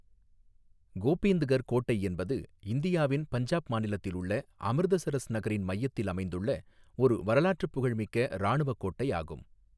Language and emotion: Tamil, neutral